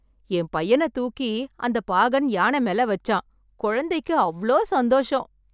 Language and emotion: Tamil, happy